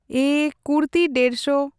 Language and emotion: Santali, neutral